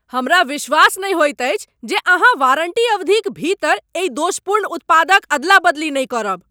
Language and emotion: Maithili, angry